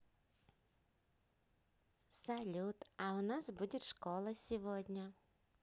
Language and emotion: Russian, positive